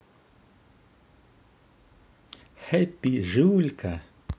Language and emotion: Russian, positive